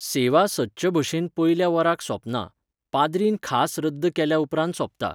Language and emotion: Goan Konkani, neutral